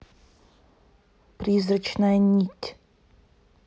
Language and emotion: Russian, neutral